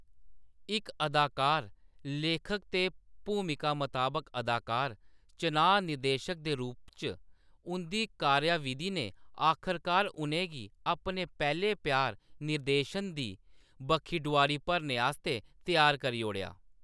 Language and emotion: Dogri, neutral